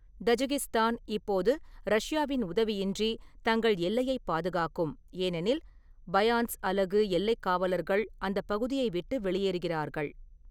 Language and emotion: Tamil, neutral